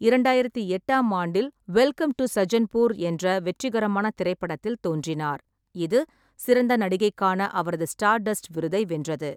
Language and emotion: Tamil, neutral